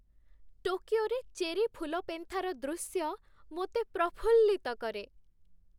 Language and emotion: Odia, happy